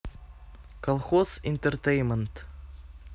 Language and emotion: Russian, neutral